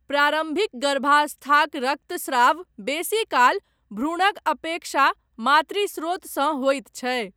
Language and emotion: Maithili, neutral